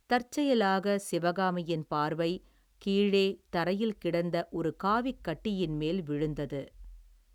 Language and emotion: Tamil, neutral